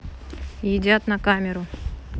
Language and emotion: Russian, neutral